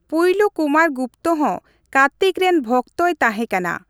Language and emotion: Santali, neutral